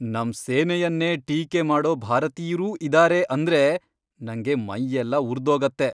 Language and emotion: Kannada, angry